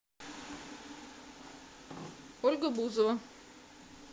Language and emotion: Russian, neutral